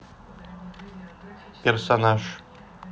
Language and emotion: Russian, neutral